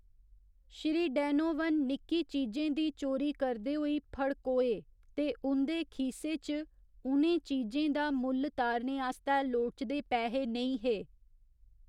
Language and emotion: Dogri, neutral